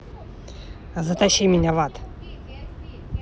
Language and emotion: Russian, angry